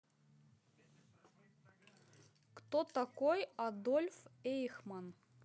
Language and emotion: Russian, neutral